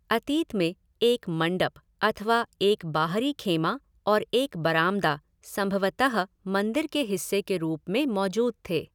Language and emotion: Hindi, neutral